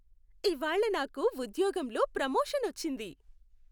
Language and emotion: Telugu, happy